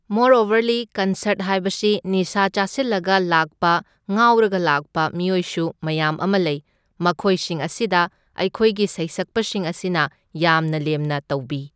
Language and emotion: Manipuri, neutral